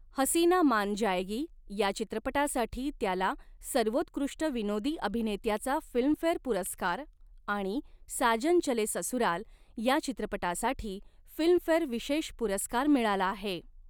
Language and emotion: Marathi, neutral